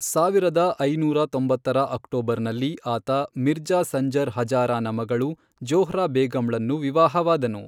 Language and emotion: Kannada, neutral